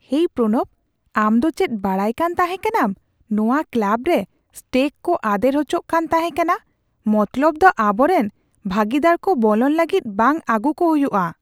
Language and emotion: Santali, surprised